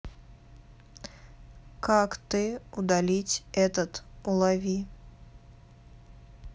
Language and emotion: Russian, neutral